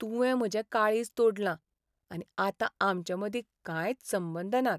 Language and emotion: Goan Konkani, sad